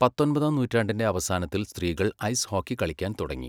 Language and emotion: Malayalam, neutral